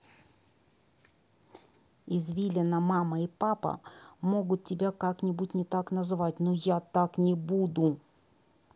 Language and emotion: Russian, angry